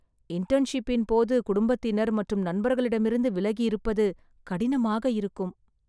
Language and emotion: Tamil, sad